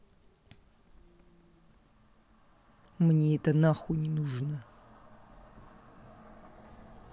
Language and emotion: Russian, angry